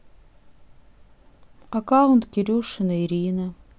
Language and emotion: Russian, sad